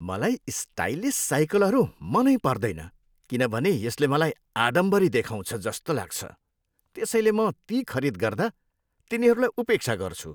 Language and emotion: Nepali, disgusted